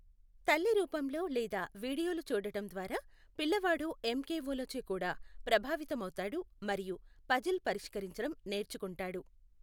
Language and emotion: Telugu, neutral